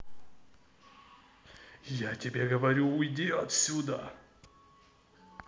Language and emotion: Russian, angry